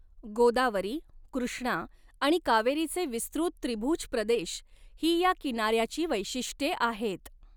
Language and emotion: Marathi, neutral